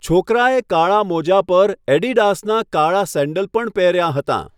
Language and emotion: Gujarati, neutral